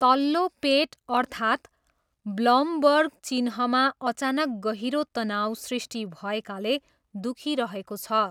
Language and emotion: Nepali, neutral